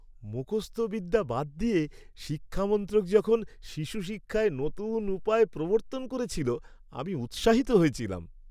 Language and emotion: Bengali, happy